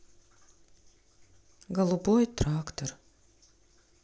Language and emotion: Russian, sad